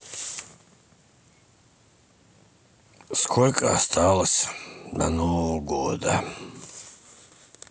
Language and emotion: Russian, sad